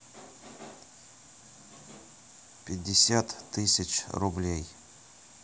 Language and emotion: Russian, neutral